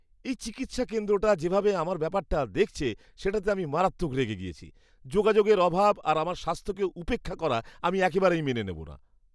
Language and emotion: Bengali, disgusted